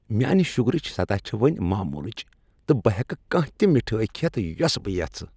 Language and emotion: Kashmiri, happy